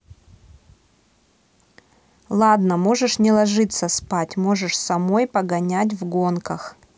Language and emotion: Russian, neutral